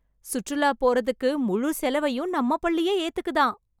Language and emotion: Tamil, happy